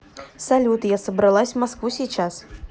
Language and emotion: Russian, neutral